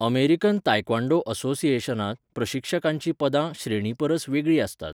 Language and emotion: Goan Konkani, neutral